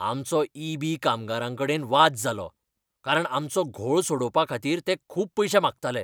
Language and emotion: Goan Konkani, angry